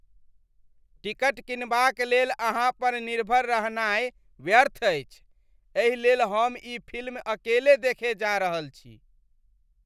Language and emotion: Maithili, disgusted